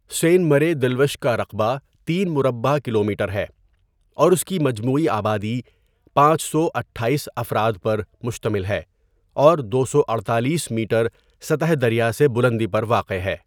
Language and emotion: Urdu, neutral